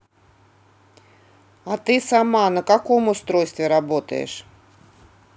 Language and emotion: Russian, neutral